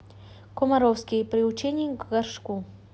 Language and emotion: Russian, neutral